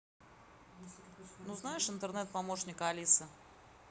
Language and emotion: Russian, neutral